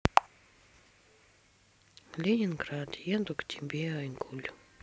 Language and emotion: Russian, sad